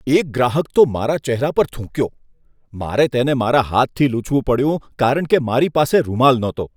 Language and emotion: Gujarati, disgusted